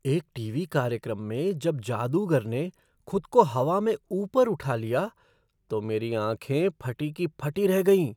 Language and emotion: Hindi, surprised